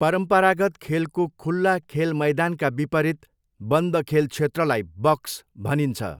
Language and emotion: Nepali, neutral